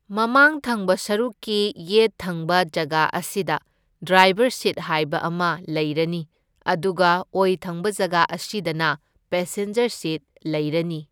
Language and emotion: Manipuri, neutral